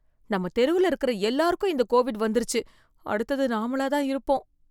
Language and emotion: Tamil, fearful